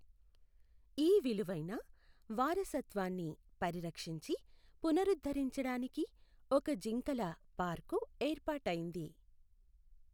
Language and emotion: Telugu, neutral